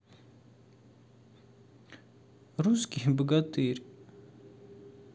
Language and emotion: Russian, sad